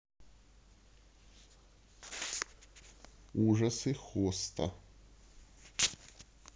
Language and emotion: Russian, neutral